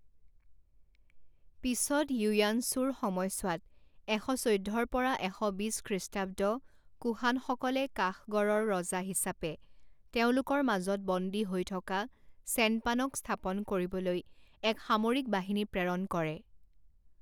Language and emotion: Assamese, neutral